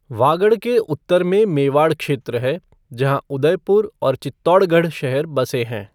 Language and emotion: Hindi, neutral